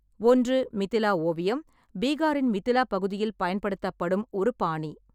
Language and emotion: Tamil, neutral